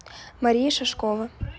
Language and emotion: Russian, neutral